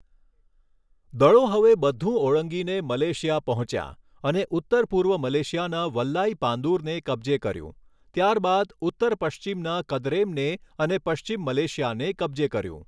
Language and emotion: Gujarati, neutral